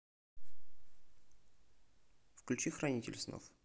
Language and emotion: Russian, neutral